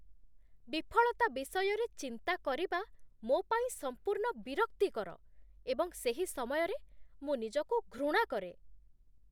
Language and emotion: Odia, disgusted